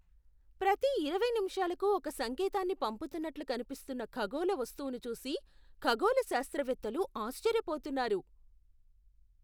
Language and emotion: Telugu, surprised